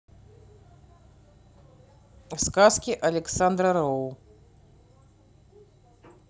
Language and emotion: Russian, neutral